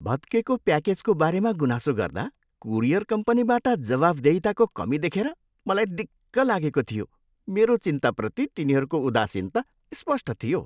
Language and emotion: Nepali, disgusted